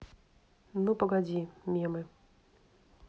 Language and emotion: Russian, neutral